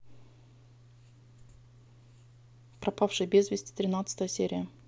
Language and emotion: Russian, neutral